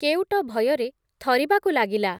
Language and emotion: Odia, neutral